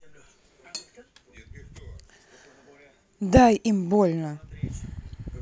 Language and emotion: Russian, neutral